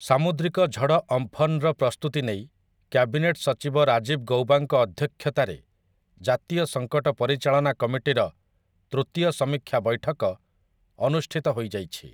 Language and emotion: Odia, neutral